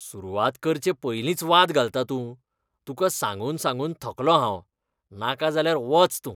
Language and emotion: Goan Konkani, disgusted